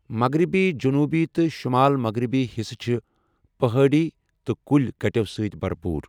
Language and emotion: Kashmiri, neutral